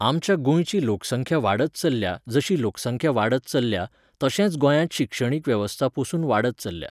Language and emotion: Goan Konkani, neutral